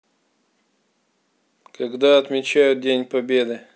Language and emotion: Russian, neutral